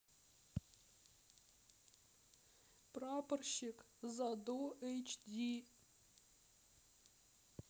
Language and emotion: Russian, sad